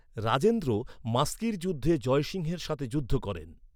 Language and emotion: Bengali, neutral